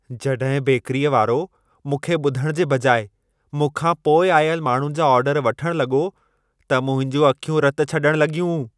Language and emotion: Sindhi, angry